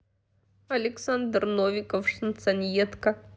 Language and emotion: Russian, sad